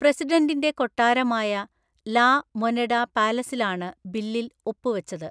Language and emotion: Malayalam, neutral